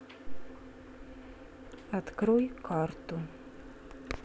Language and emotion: Russian, neutral